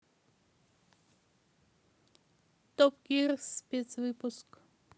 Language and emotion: Russian, neutral